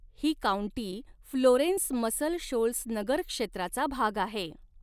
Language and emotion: Marathi, neutral